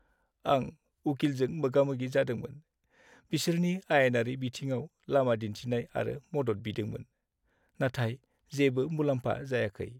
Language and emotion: Bodo, sad